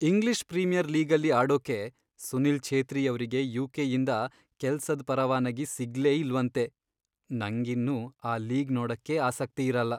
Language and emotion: Kannada, sad